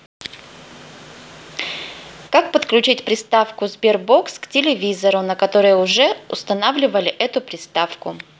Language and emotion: Russian, neutral